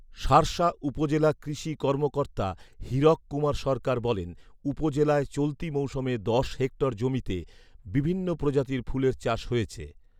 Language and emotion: Bengali, neutral